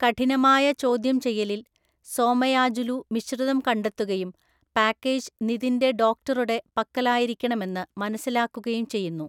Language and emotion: Malayalam, neutral